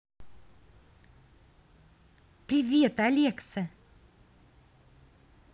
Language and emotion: Russian, positive